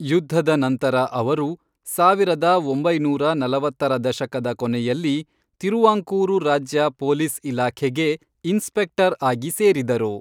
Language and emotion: Kannada, neutral